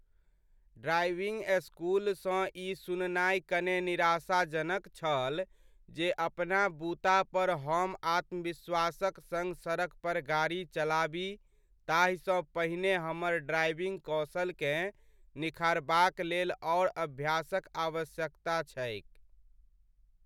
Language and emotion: Maithili, sad